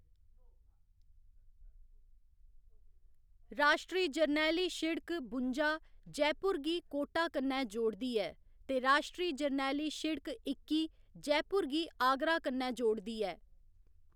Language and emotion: Dogri, neutral